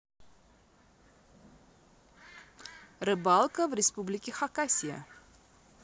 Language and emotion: Russian, positive